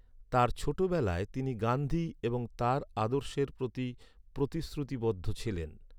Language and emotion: Bengali, neutral